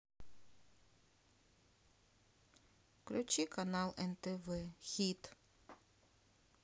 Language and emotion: Russian, sad